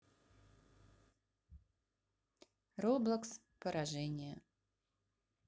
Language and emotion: Russian, neutral